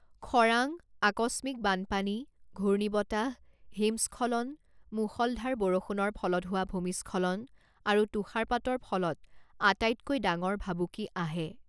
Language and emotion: Assamese, neutral